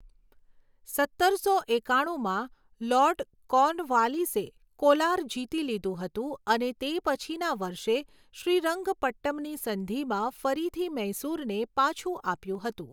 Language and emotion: Gujarati, neutral